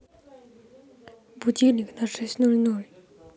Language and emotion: Russian, neutral